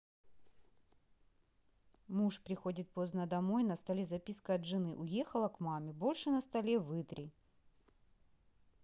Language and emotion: Russian, neutral